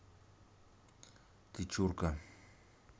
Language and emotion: Russian, neutral